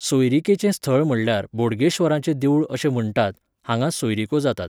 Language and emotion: Goan Konkani, neutral